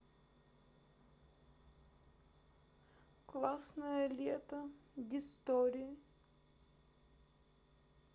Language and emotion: Russian, sad